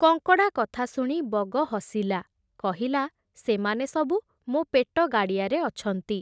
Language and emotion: Odia, neutral